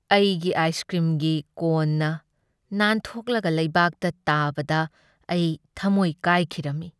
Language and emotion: Manipuri, sad